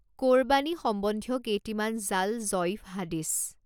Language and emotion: Assamese, neutral